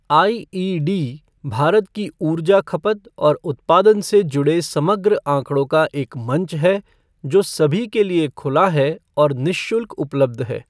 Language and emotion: Hindi, neutral